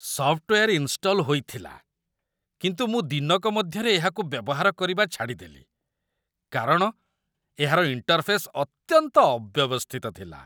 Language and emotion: Odia, disgusted